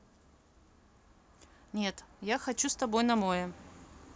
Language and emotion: Russian, neutral